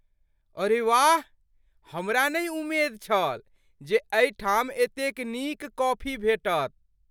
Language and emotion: Maithili, surprised